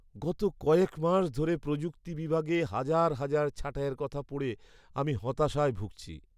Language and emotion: Bengali, sad